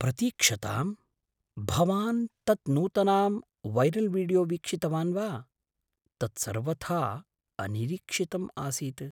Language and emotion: Sanskrit, surprised